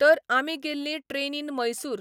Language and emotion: Goan Konkani, neutral